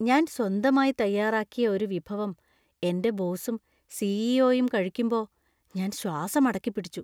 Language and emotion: Malayalam, fearful